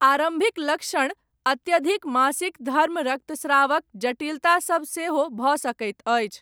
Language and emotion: Maithili, neutral